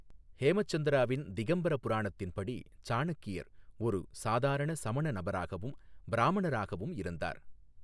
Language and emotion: Tamil, neutral